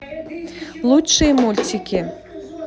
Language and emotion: Russian, positive